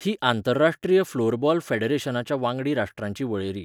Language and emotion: Goan Konkani, neutral